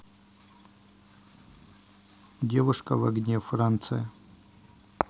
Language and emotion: Russian, neutral